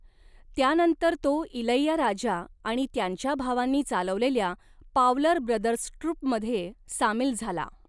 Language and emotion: Marathi, neutral